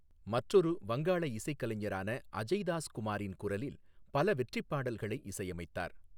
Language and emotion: Tamil, neutral